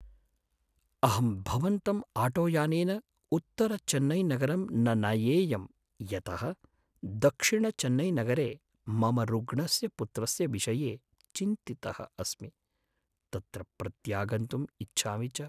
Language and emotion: Sanskrit, sad